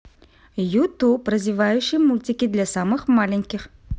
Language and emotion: Russian, positive